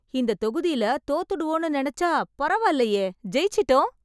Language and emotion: Tamil, happy